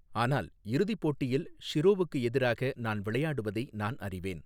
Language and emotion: Tamil, neutral